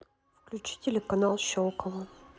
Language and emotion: Russian, neutral